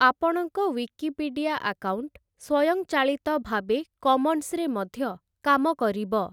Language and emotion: Odia, neutral